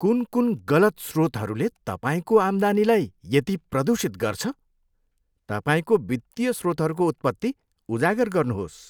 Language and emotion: Nepali, disgusted